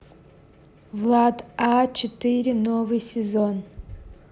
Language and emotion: Russian, neutral